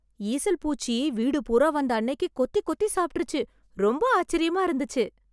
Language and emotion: Tamil, surprised